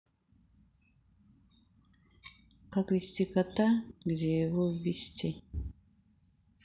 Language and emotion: Russian, sad